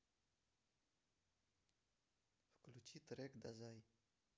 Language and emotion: Russian, neutral